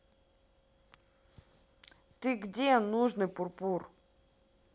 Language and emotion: Russian, angry